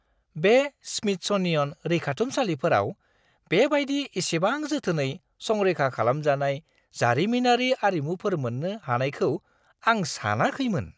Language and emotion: Bodo, surprised